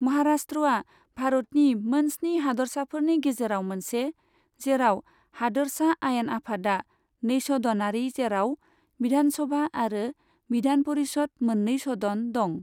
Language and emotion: Bodo, neutral